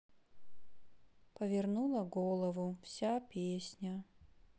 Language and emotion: Russian, sad